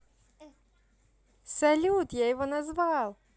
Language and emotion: Russian, positive